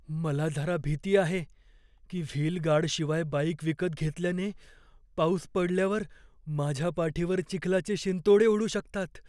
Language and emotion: Marathi, fearful